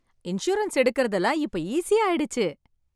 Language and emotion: Tamil, happy